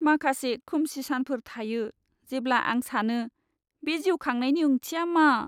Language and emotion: Bodo, sad